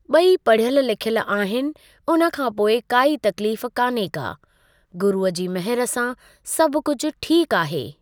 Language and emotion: Sindhi, neutral